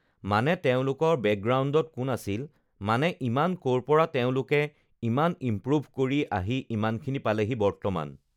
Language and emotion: Assamese, neutral